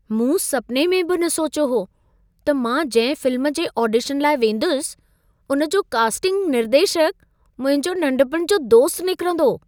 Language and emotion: Sindhi, surprised